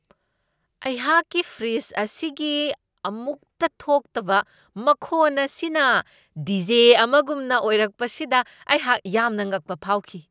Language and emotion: Manipuri, surprised